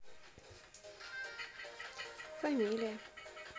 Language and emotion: Russian, neutral